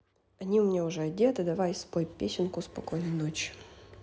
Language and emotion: Russian, neutral